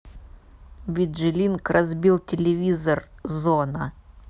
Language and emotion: Russian, neutral